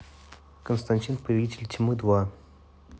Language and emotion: Russian, neutral